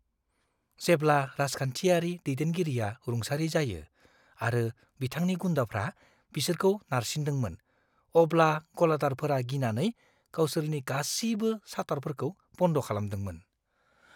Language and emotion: Bodo, fearful